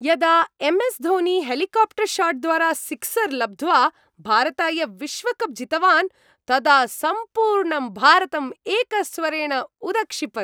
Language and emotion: Sanskrit, happy